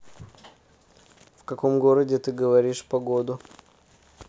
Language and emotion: Russian, neutral